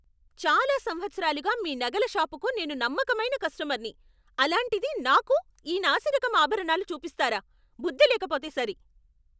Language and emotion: Telugu, angry